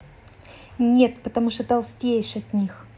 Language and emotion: Russian, angry